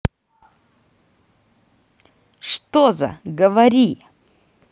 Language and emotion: Russian, angry